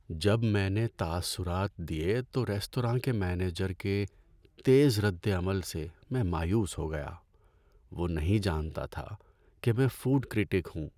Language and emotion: Urdu, sad